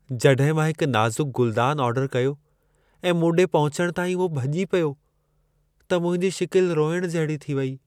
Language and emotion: Sindhi, sad